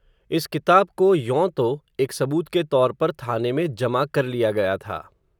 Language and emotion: Hindi, neutral